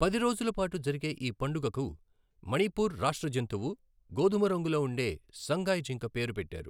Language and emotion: Telugu, neutral